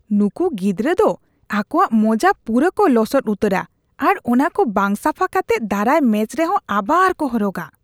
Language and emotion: Santali, disgusted